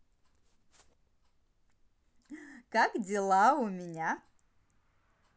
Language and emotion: Russian, positive